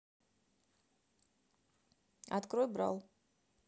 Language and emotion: Russian, neutral